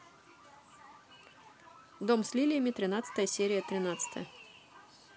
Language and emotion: Russian, neutral